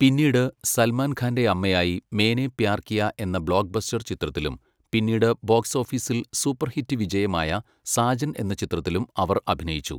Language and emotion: Malayalam, neutral